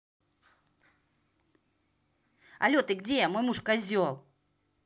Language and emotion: Russian, angry